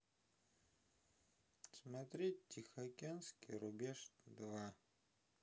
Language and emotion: Russian, neutral